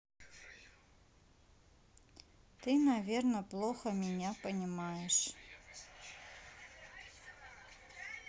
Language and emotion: Russian, sad